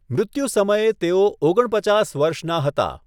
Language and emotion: Gujarati, neutral